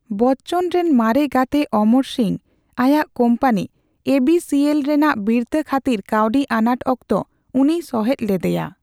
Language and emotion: Santali, neutral